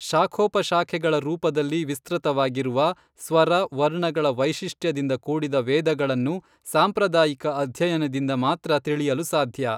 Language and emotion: Kannada, neutral